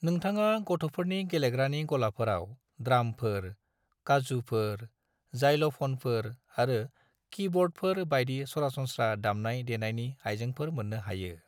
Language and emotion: Bodo, neutral